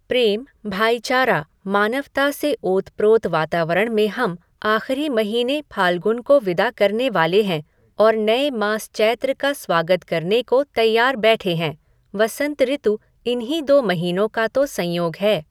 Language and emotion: Hindi, neutral